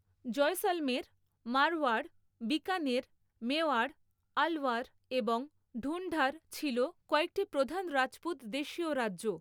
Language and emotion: Bengali, neutral